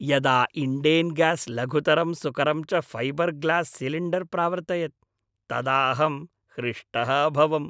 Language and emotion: Sanskrit, happy